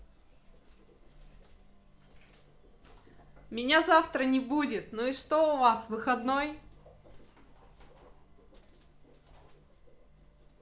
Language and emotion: Russian, positive